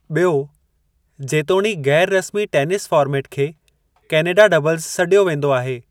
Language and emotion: Sindhi, neutral